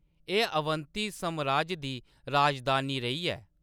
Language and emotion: Dogri, neutral